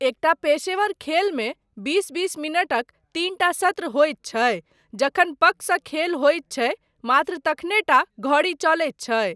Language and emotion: Maithili, neutral